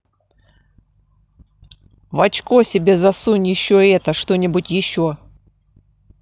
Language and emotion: Russian, angry